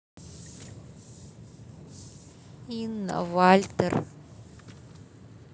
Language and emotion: Russian, sad